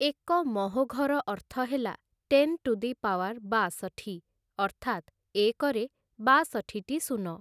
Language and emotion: Odia, neutral